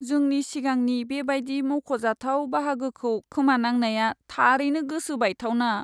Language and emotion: Bodo, sad